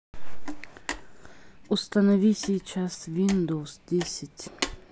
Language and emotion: Russian, neutral